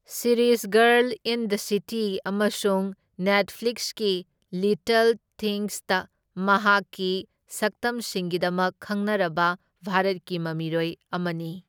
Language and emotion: Manipuri, neutral